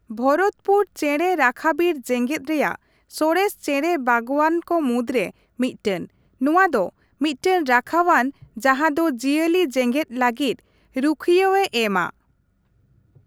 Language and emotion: Santali, neutral